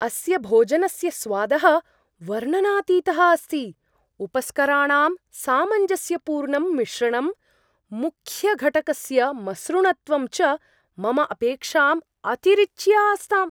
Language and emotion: Sanskrit, surprised